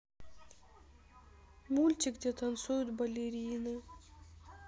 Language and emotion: Russian, sad